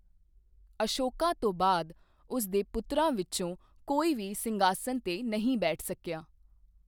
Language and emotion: Punjabi, neutral